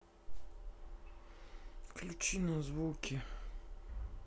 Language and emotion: Russian, sad